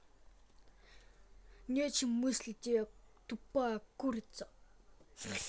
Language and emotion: Russian, angry